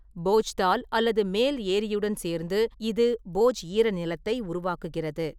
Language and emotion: Tamil, neutral